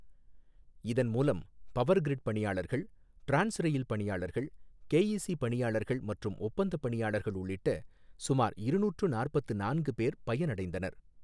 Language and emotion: Tamil, neutral